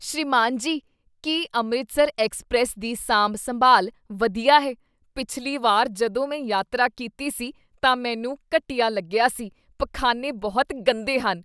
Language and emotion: Punjabi, disgusted